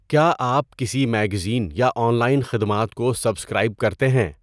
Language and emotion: Urdu, neutral